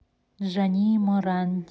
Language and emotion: Russian, neutral